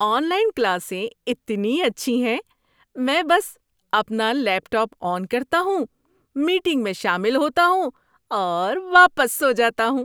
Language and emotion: Urdu, happy